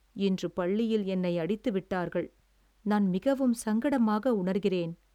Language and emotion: Tamil, sad